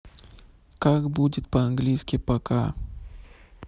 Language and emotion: Russian, neutral